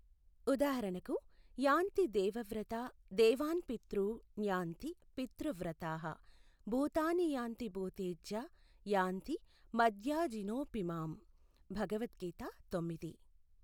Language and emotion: Telugu, neutral